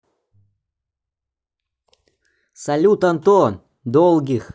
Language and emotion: Russian, positive